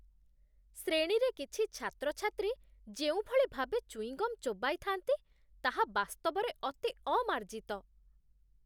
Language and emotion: Odia, disgusted